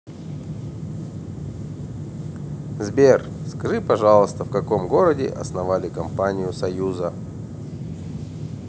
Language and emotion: Russian, neutral